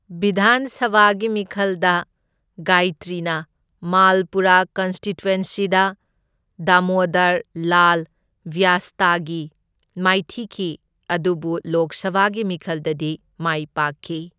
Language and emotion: Manipuri, neutral